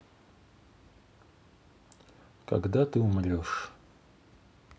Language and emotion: Russian, sad